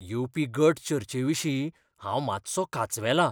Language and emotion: Goan Konkani, fearful